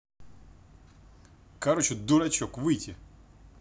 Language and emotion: Russian, angry